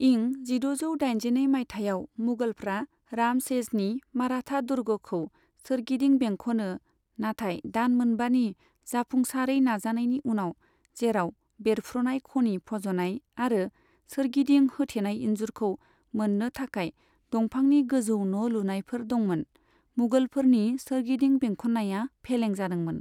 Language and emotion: Bodo, neutral